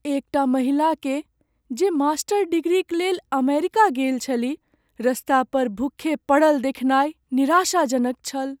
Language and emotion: Maithili, sad